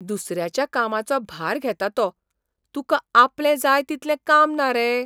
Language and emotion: Goan Konkani, surprised